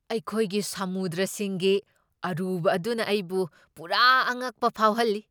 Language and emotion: Manipuri, surprised